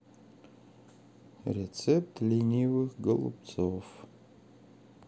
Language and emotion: Russian, sad